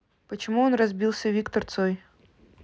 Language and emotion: Russian, neutral